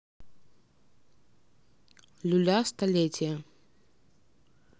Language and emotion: Russian, neutral